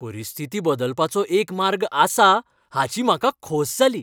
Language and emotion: Goan Konkani, happy